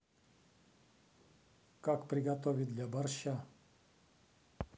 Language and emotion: Russian, neutral